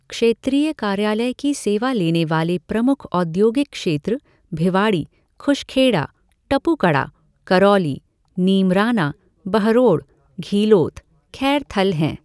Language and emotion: Hindi, neutral